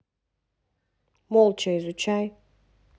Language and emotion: Russian, neutral